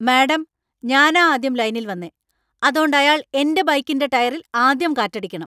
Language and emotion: Malayalam, angry